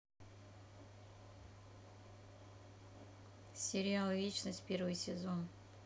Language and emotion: Russian, neutral